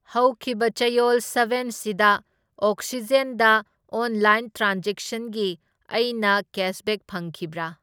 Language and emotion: Manipuri, neutral